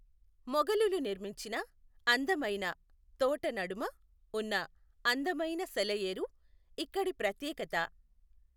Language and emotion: Telugu, neutral